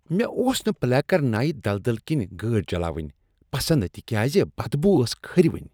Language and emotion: Kashmiri, disgusted